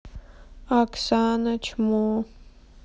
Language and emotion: Russian, sad